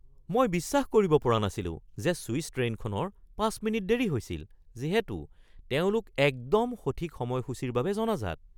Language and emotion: Assamese, surprised